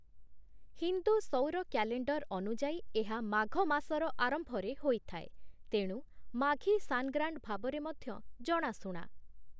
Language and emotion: Odia, neutral